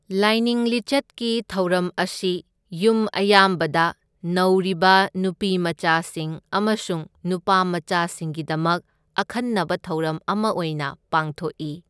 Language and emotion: Manipuri, neutral